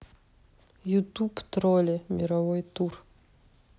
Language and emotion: Russian, neutral